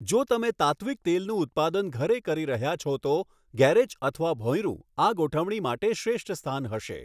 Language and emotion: Gujarati, neutral